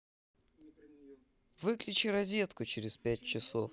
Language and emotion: Russian, neutral